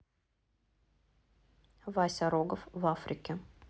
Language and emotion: Russian, neutral